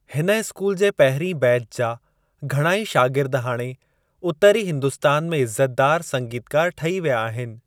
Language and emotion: Sindhi, neutral